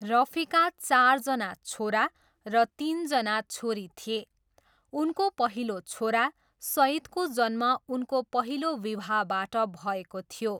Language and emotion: Nepali, neutral